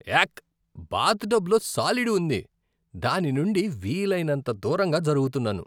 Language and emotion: Telugu, disgusted